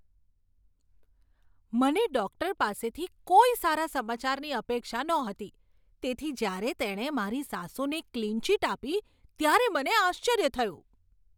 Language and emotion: Gujarati, surprised